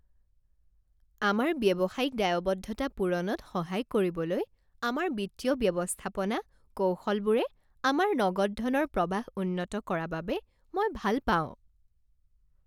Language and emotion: Assamese, happy